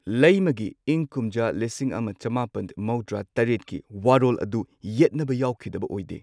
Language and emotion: Manipuri, neutral